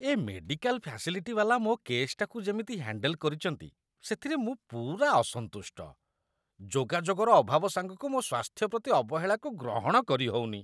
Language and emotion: Odia, disgusted